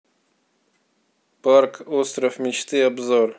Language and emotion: Russian, neutral